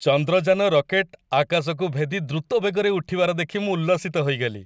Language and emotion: Odia, happy